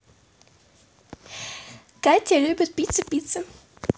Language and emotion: Russian, positive